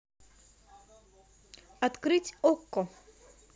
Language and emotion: Russian, positive